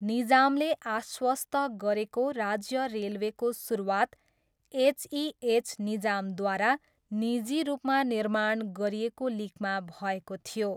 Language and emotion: Nepali, neutral